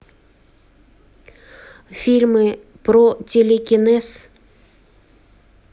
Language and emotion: Russian, neutral